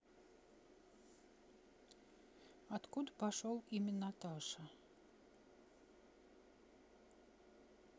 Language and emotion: Russian, neutral